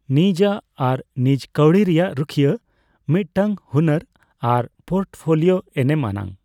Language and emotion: Santali, neutral